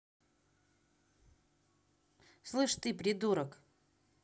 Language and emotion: Russian, angry